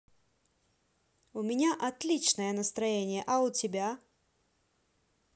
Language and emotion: Russian, positive